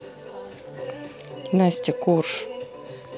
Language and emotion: Russian, neutral